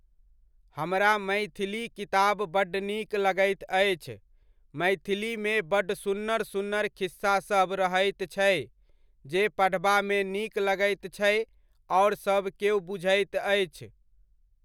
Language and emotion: Maithili, neutral